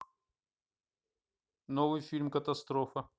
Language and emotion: Russian, neutral